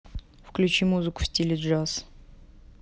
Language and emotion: Russian, neutral